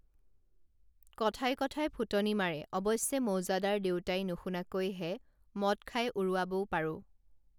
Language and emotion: Assamese, neutral